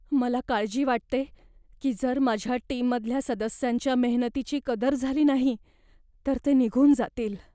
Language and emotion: Marathi, fearful